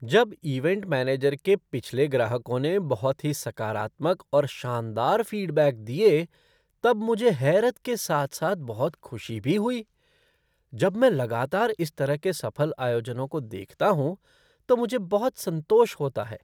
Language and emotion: Hindi, surprised